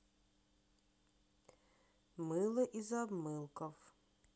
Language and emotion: Russian, neutral